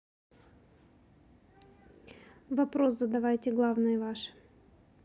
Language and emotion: Russian, neutral